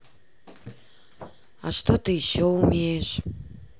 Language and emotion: Russian, sad